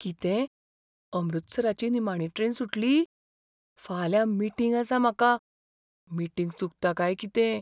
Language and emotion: Goan Konkani, fearful